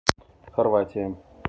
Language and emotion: Russian, neutral